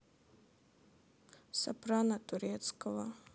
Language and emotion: Russian, sad